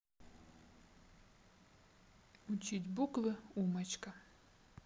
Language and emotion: Russian, neutral